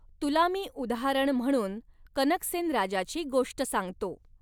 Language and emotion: Marathi, neutral